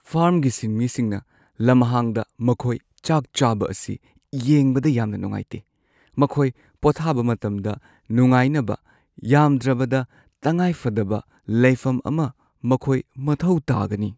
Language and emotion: Manipuri, sad